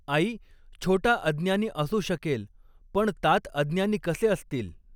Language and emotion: Marathi, neutral